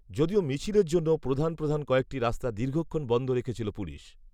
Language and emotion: Bengali, neutral